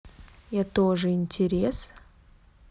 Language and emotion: Russian, neutral